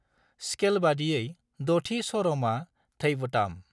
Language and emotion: Bodo, neutral